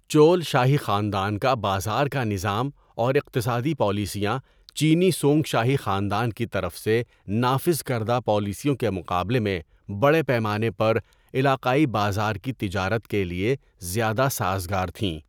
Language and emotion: Urdu, neutral